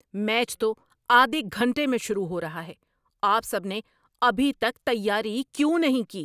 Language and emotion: Urdu, angry